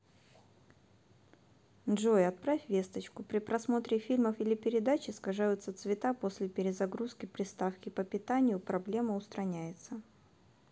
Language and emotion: Russian, neutral